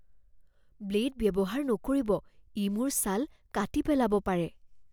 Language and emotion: Assamese, fearful